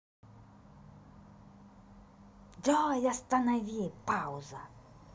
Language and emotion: Russian, angry